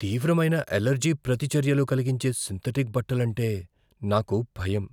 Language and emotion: Telugu, fearful